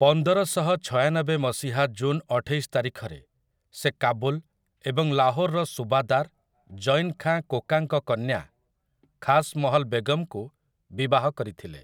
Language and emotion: Odia, neutral